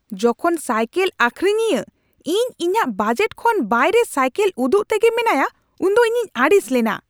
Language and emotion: Santali, angry